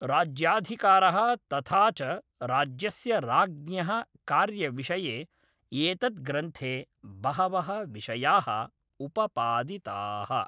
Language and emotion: Sanskrit, neutral